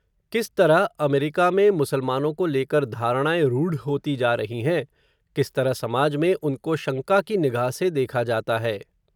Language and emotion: Hindi, neutral